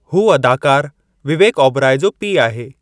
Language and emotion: Sindhi, neutral